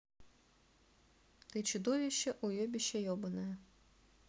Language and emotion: Russian, neutral